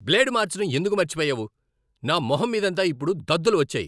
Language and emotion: Telugu, angry